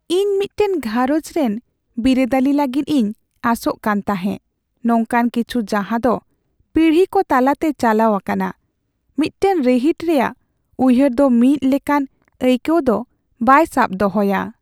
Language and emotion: Santali, sad